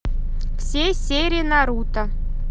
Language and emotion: Russian, neutral